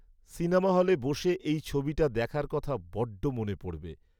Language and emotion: Bengali, sad